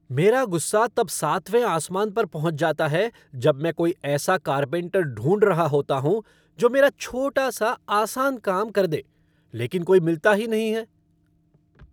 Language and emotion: Hindi, angry